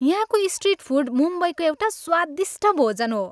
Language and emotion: Nepali, happy